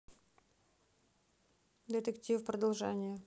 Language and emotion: Russian, neutral